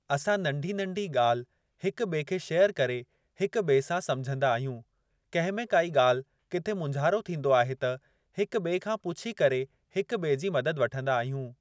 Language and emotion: Sindhi, neutral